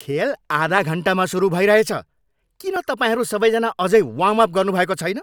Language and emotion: Nepali, angry